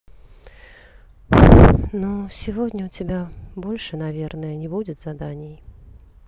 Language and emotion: Russian, sad